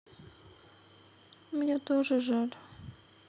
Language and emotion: Russian, sad